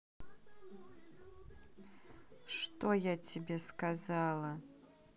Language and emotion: Russian, angry